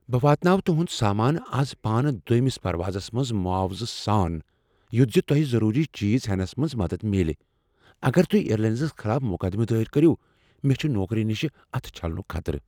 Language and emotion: Kashmiri, fearful